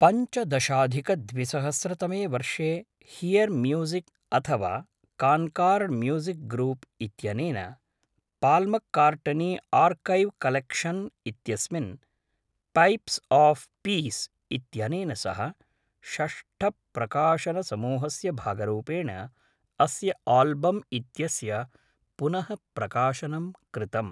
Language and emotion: Sanskrit, neutral